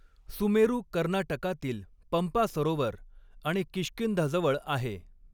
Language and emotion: Marathi, neutral